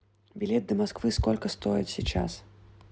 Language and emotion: Russian, neutral